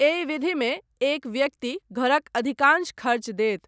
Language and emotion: Maithili, neutral